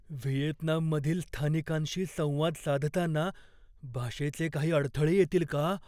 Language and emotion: Marathi, fearful